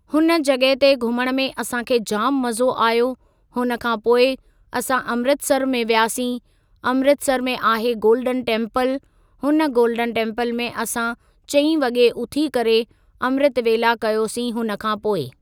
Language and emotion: Sindhi, neutral